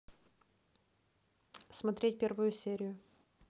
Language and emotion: Russian, neutral